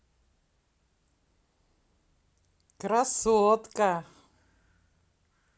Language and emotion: Russian, positive